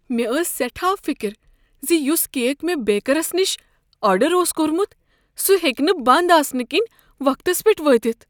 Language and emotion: Kashmiri, fearful